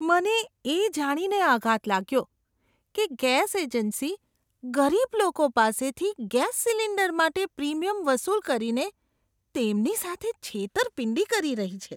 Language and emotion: Gujarati, disgusted